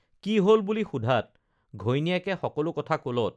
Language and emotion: Assamese, neutral